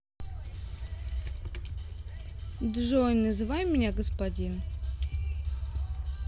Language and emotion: Russian, neutral